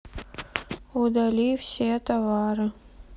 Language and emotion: Russian, sad